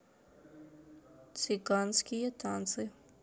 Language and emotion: Russian, neutral